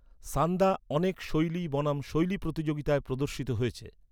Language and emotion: Bengali, neutral